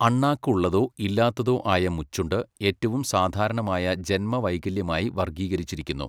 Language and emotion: Malayalam, neutral